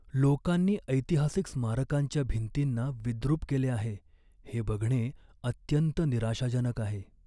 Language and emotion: Marathi, sad